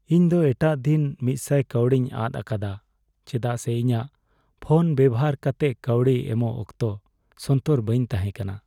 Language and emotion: Santali, sad